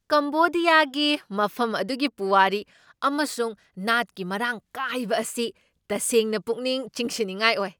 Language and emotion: Manipuri, surprised